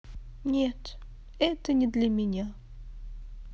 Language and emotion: Russian, sad